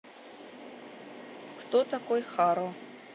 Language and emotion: Russian, neutral